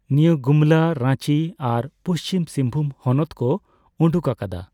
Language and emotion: Santali, neutral